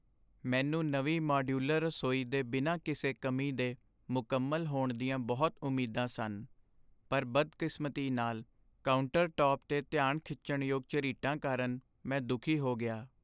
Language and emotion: Punjabi, sad